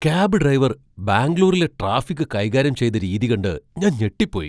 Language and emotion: Malayalam, surprised